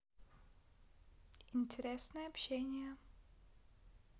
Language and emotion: Russian, neutral